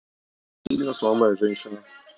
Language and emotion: Russian, neutral